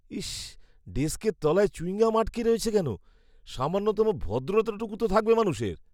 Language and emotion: Bengali, disgusted